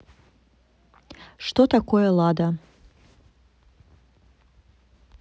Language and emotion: Russian, neutral